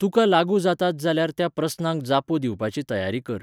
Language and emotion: Goan Konkani, neutral